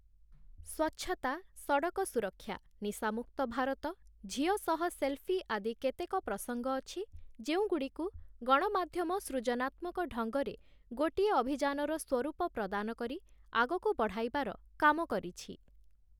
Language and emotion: Odia, neutral